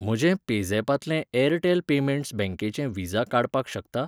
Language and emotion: Goan Konkani, neutral